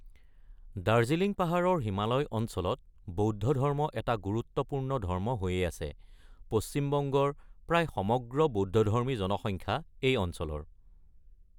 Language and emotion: Assamese, neutral